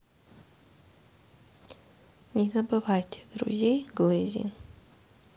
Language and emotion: Russian, neutral